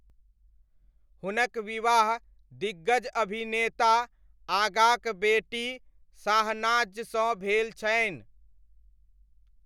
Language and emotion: Maithili, neutral